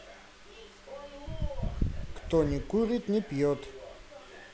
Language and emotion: Russian, neutral